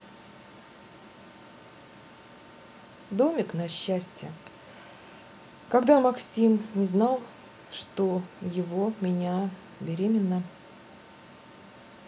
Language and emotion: Russian, neutral